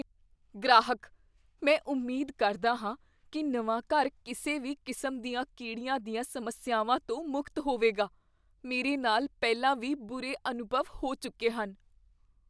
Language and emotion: Punjabi, fearful